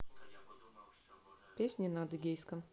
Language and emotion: Russian, neutral